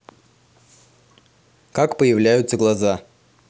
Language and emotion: Russian, neutral